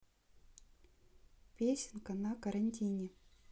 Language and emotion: Russian, neutral